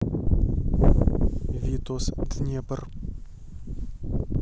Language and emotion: Russian, neutral